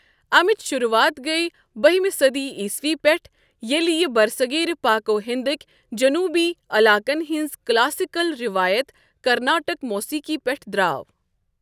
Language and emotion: Kashmiri, neutral